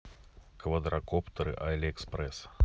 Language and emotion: Russian, neutral